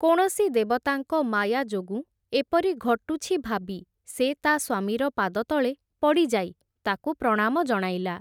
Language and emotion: Odia, neutral